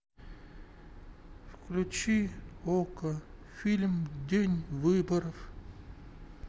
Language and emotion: Russian, sad